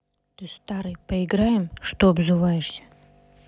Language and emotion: Russian, neutral